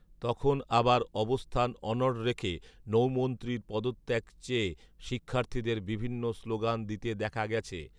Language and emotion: Bengali, neutral